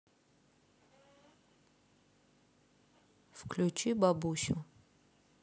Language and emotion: Russian, neutral